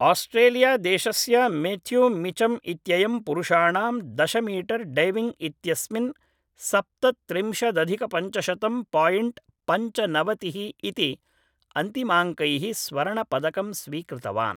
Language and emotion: Sanskrit, neutral